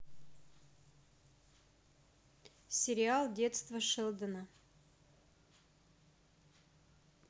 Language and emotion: Russian, neutral